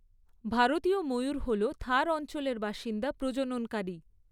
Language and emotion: Bengali, neutral